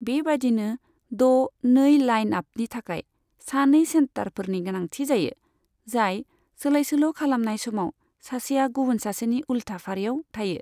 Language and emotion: Bodo, neutral